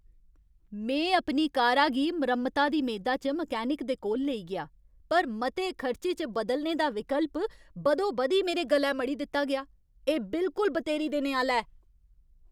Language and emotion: Dogri, angry